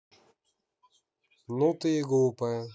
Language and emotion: Russian, angry